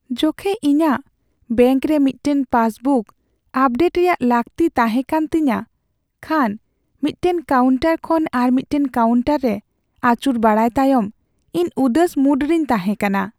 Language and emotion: Santali, sad